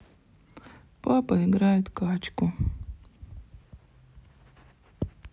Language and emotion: Russian, sad